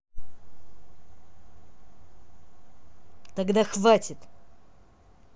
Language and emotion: Russian, angry